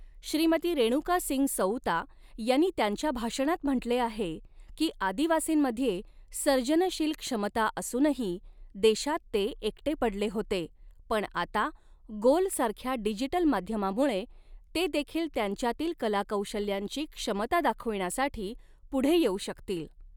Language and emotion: Marathi, neutral